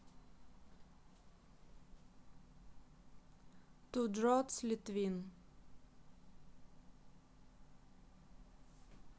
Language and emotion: Russian, neutral